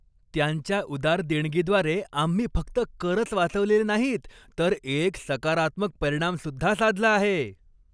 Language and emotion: Marathi, happy